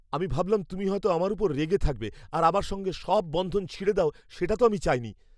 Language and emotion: Bengali, fearful